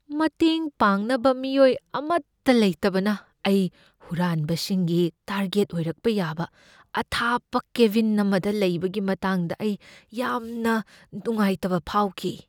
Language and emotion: Manipuri, fearful